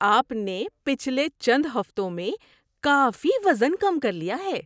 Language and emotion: Urdu, surprised